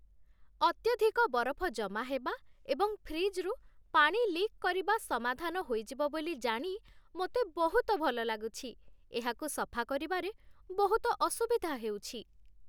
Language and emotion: Odia, happy